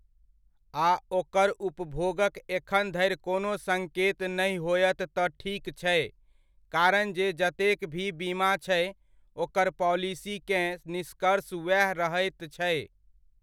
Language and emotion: Maithili, neutral